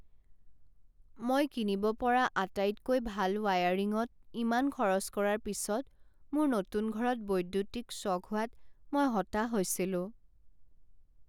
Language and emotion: Assamese, sad